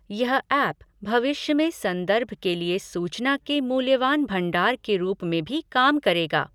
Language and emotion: Hindi, neutral